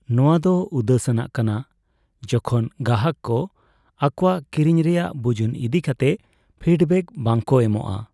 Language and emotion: Santali, sad